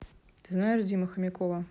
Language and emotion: Russian, neutral